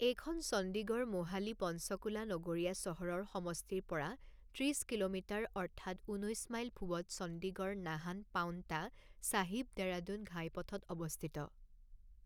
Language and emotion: Assamese, neutral